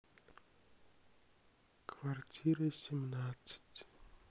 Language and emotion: Russian, sad